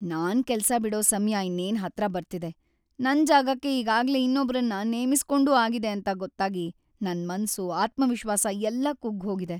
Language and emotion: Kannada, sad